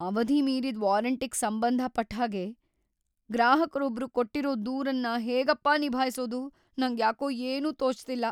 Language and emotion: Kannada, fearful